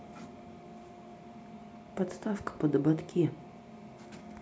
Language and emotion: Russian, neutral